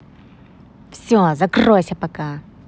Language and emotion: Russian, angry